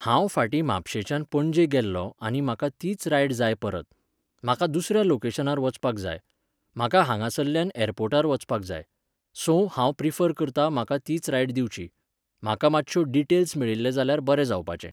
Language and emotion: Goan Konkani, neutral